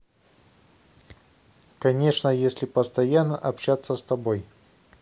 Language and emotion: Russian, neutral